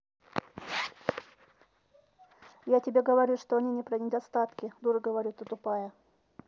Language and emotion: Russian, neutral